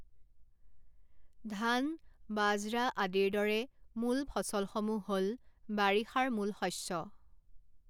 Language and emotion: Assamese, neutral